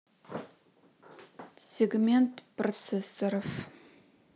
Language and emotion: Russian, neutral